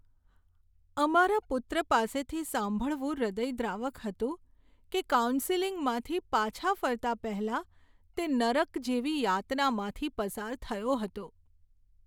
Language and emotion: Gujarati, sad